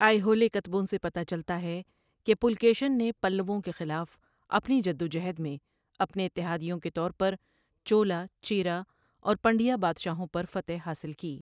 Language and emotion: Urdu, neutral